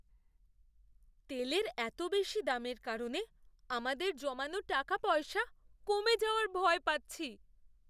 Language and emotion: Bengali, fearful